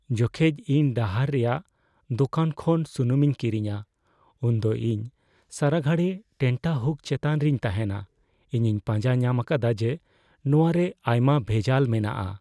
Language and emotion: Santali, fearful